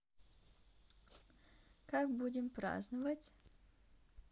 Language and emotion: Russian, neutral